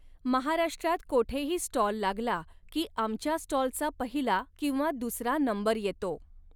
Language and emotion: Marathi, neutral